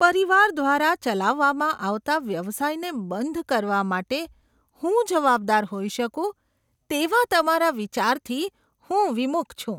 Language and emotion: Gujarati, disgusted